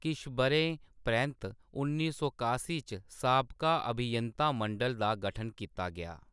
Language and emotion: Dogri, neutral